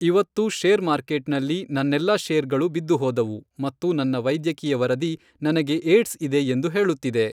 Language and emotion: Kannada, neutral